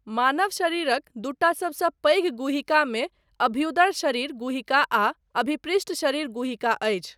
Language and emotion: Maithili, neutral